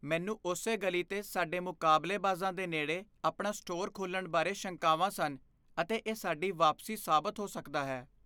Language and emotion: Punjabi, fearful